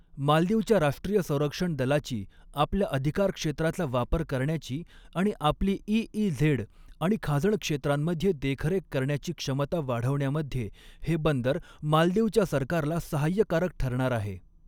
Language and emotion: Marathi, neutral